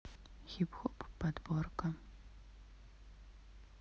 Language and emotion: Russian, neutral